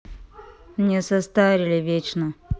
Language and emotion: Russian, neutral